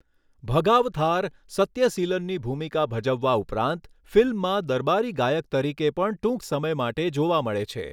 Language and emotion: Gujarati, neutral